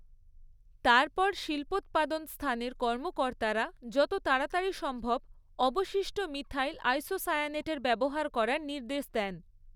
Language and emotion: Bengali, neutral